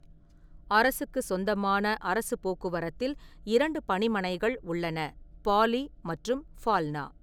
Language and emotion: Tamil, neutral